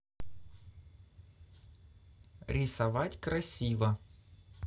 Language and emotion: Russian, positive